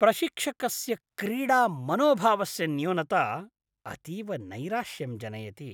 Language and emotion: Sanskrit, disgusted